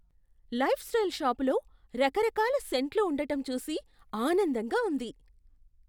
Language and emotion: Telugu, surprised